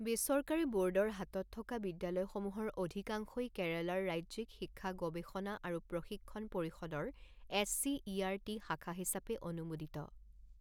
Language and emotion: Assamese, neutral